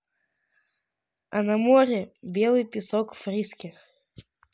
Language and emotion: Russian, neutral